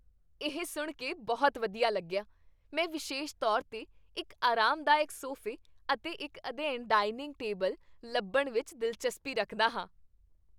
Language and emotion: Punjabi, happy